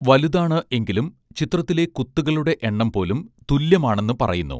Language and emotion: Malayalam, neutral